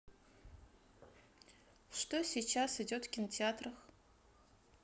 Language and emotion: Russian, neutral